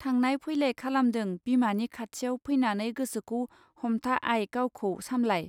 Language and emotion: Bodo, neutral